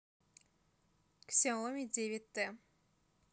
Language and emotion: Russian, neutral